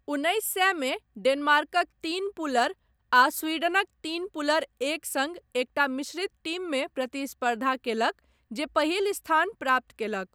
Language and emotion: Maithili, neutral